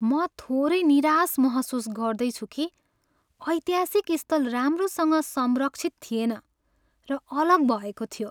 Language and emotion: Nepali, sad